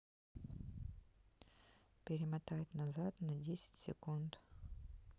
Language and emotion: Russian, neutral